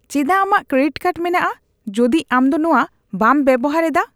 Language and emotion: Santali, disgusted